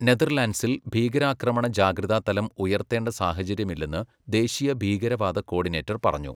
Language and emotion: Malayalam, neutral